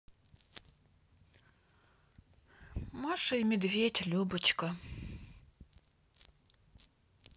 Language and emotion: Russian, sad